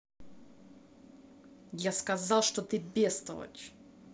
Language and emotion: Russian, angry